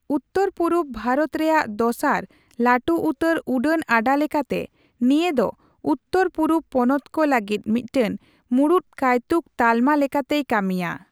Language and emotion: Santali, neutral